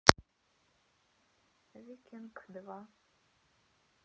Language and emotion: Russian, sad